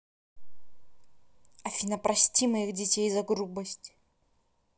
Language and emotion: Russian, angry